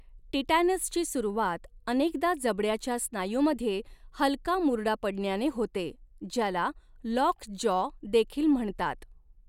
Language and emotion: Marathi, neutral